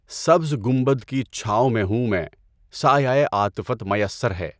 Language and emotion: Urdu, neutral